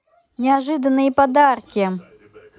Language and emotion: Russian, positive